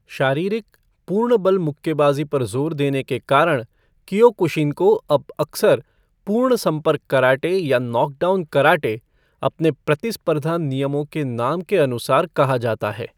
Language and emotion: Hindi, neutral